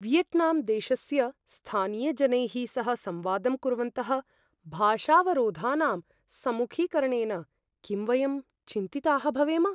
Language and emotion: Sanskrit, fearful